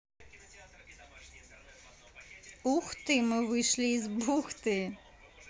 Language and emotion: Russian, positive